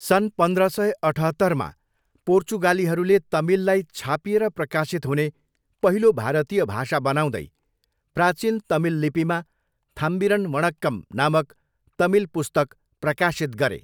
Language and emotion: Nepali, neutral